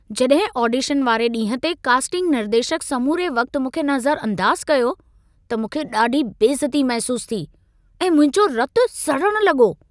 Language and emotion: Sindhi, angry